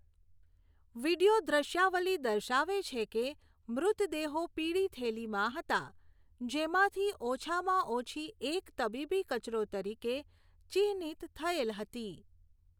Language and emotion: Gujarati, neutral